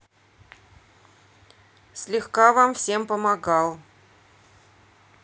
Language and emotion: Russian, neutral